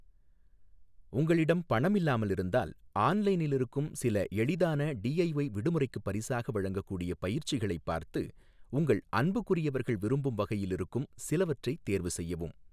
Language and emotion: Tamil, neutral